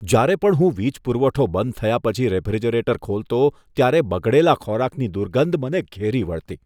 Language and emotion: Gujarati, disgusted